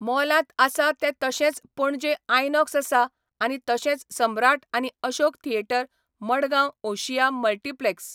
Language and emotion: Goan Konkani, neutral